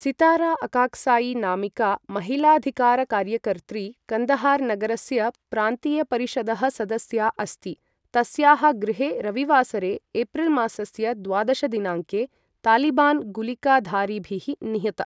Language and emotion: Sanskrit, neutral